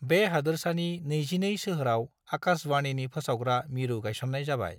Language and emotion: Bodo, neutral